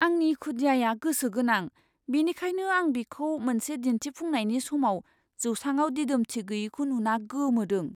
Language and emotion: Bodo, surprised